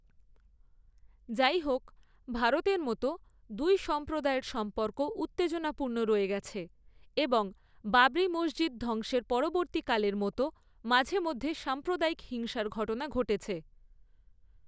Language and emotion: Bengali, neutral